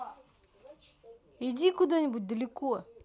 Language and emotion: Russian, angry